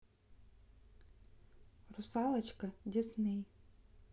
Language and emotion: Russian, neutral